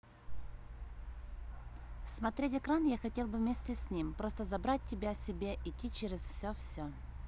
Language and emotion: Russian, neutral